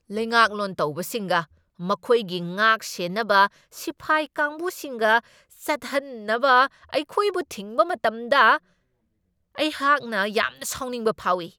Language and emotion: Manipuri, angry